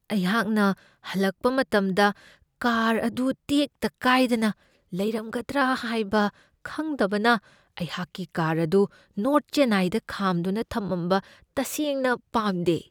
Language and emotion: Manipuri, fearful